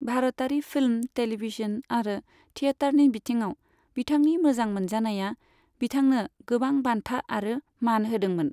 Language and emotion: Bodo, neutral